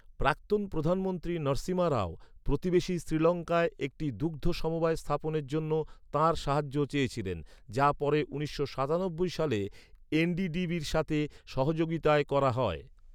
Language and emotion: Bengali, neutral